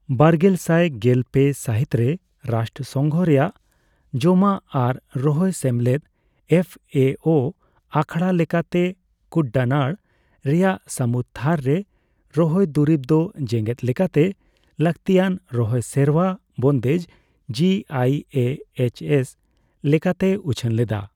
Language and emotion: Santali, neutral